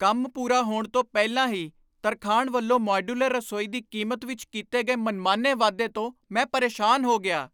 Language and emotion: Punjabi, angry